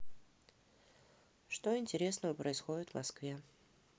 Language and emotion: Russian, neutral